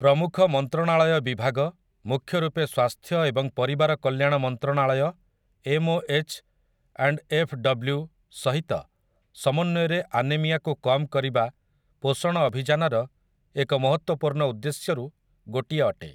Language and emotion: Odia, neutral